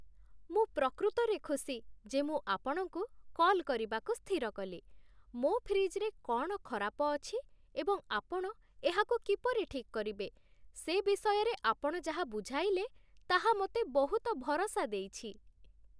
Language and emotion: Odia, happy